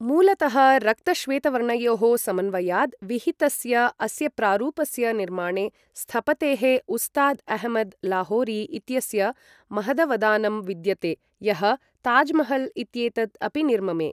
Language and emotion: Sanskrit, neutral